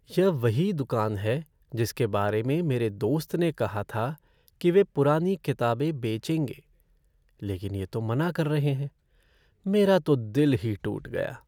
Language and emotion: Hindi, sad